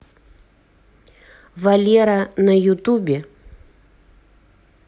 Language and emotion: Russian, neutral